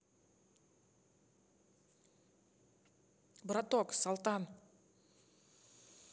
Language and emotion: Russian, neutral